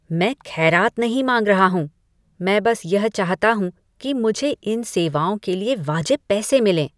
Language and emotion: Hindi, disgusted